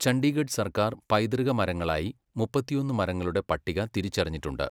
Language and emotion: Malayalam, neutral